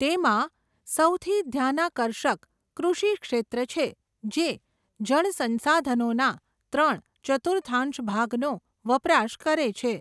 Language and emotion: Gujarati, neutral